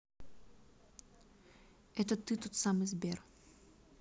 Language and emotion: Russian, neutral